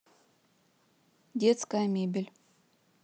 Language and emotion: Russian, neutral